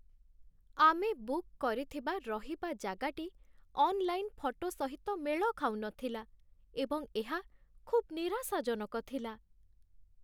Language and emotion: Odia, sad